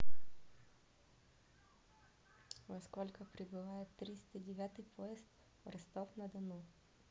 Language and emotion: Russian, neutral